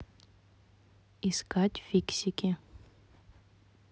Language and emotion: Russian, neutral